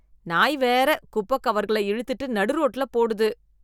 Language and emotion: Tamil, disgusted